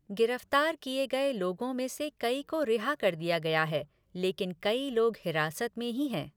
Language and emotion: Hindi, neutral